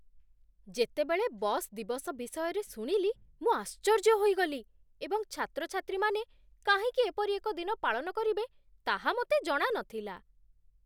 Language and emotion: Odia, surprised